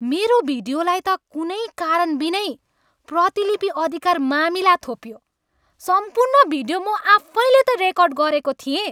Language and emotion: Nepali, angry